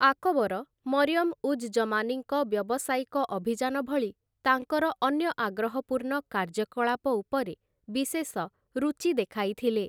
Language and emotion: Odia, neutral